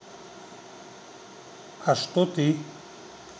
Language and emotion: Russian, neutral